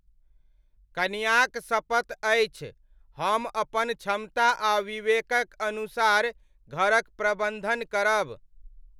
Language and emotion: Maithili, neutral